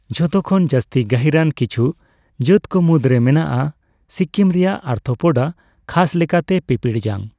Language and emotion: Santali, neutral